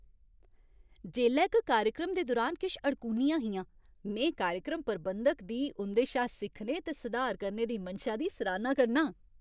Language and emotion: Dogri, happy